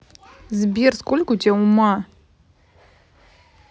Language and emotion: Russian, neutral